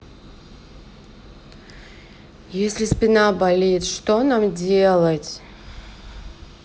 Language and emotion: Russian, sad